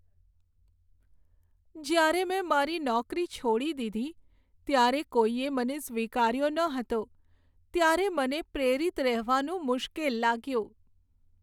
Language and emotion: Gujarati, sad